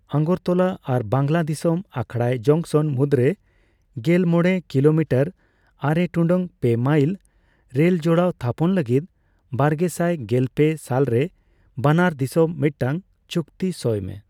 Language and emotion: Santali, neutral